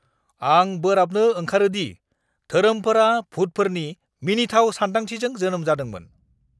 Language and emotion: Bodo, angry